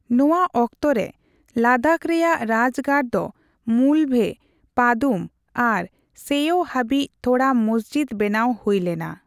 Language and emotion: Santali, neutral